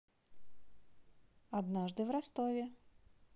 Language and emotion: Russian, positive